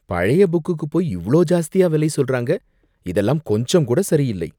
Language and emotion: Tamil, disgusted